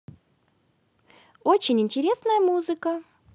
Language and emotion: Russian, positive